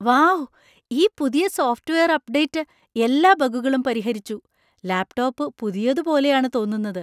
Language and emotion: Malayalam, surprised